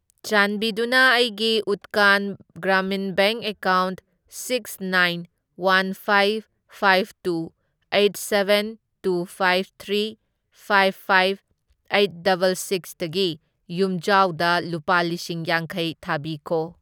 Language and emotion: Manipuri, neutral